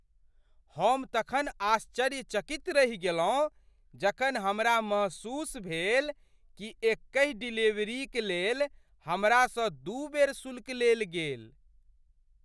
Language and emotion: Maithili, surprised